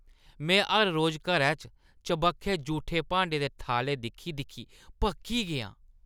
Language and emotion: Dogri, disgusted